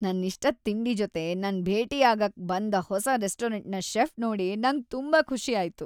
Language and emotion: Kannada, happy